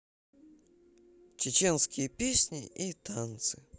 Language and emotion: Russian, neutral